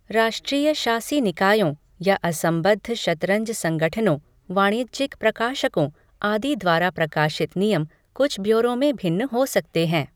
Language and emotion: Hindi, neutral